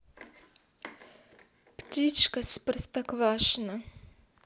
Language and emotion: Russian, neutral